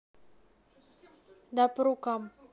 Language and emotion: Russian, neutral